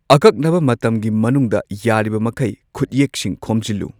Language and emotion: Manipuri, neutral